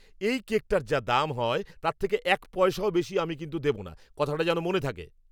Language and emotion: Bengali, angry